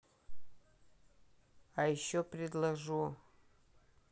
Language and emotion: Russian, neutral